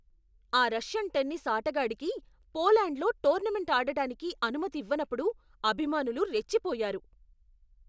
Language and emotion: Telugu, angry